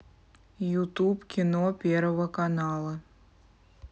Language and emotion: Russian, neutral